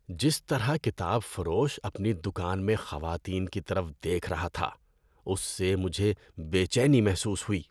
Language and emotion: Urdu, disgusted